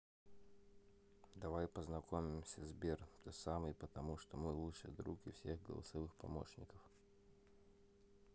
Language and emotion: Russian, neutral